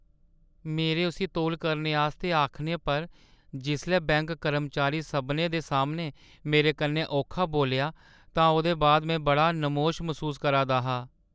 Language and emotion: Dogri, sad